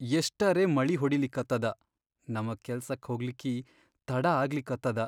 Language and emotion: Kannada, sad